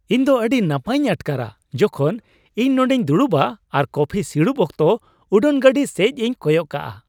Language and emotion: Santali, happy